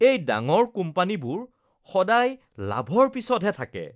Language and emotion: Assamese, disgusted